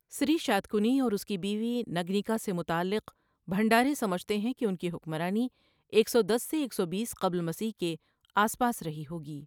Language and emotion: Urdu, neutral